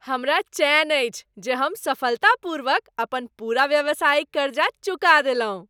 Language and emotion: Maithili, happy